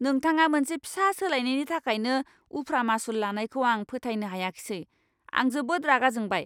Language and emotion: Bodo, angry